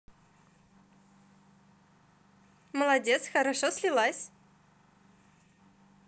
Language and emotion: Russian, positive